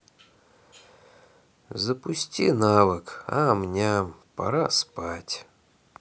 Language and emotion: Russian, sad